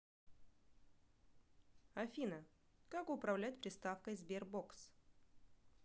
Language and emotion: Russian, neutral